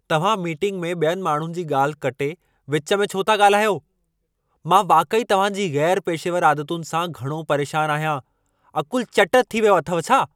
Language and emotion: Sindhi, angry